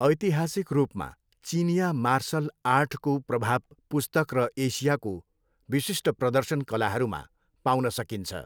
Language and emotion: Nepali, neutral